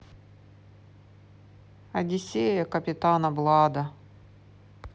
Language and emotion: Russian, sad